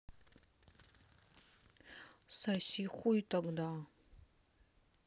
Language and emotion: Russian, neutral